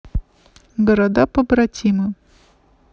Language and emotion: Russian, neutral